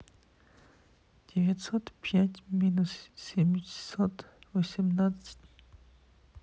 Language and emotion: Russian, sad